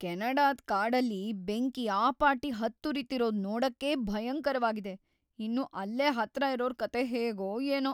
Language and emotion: Kannada, fearful